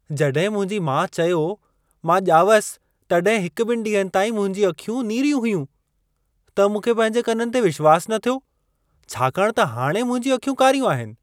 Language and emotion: Sindhi, surprised